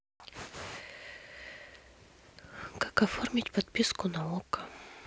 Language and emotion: Russian, sad